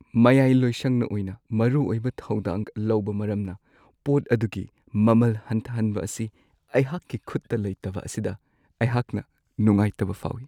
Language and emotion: Manipuri, sad